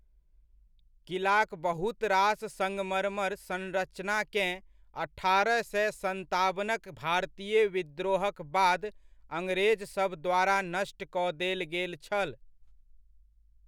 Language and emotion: Maithili, neutral